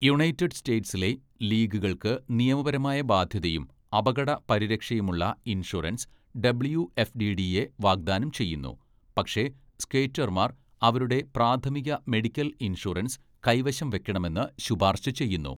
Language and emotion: Malayalam, neutral